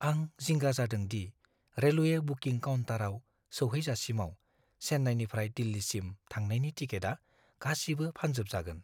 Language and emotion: Bodo, fearful